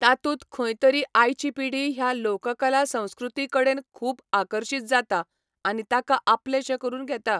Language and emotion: Goan Konkani, neutral